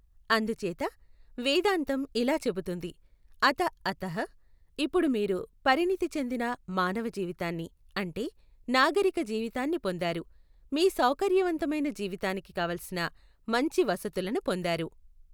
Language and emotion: Telugu, neutral